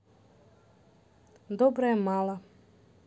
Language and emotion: Russian, neutral